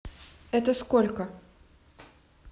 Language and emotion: Russian, neutral